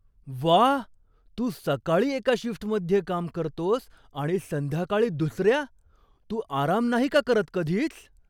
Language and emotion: Marathi, surprised